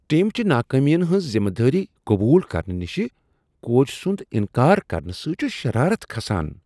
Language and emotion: Kashmiri, disgusted